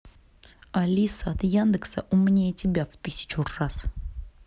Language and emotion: Russian, angry